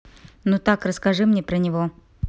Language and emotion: Russian, neutral